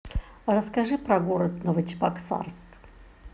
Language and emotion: Russian, neutral